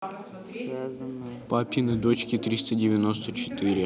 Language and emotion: Russian, neutral